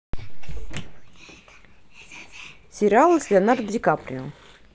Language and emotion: Russian, neutral